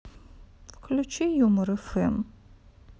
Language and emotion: Russian, sad